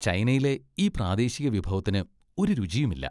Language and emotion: Malayalam, disgusted